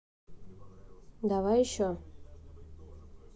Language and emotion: Russian, neutral